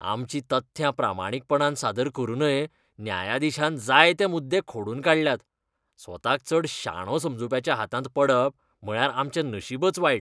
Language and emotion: Goan Konkani, disgusted